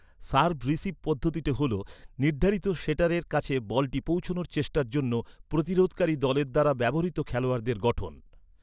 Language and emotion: Bengali, neutral